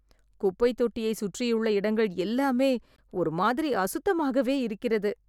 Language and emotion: Tamil, disgusted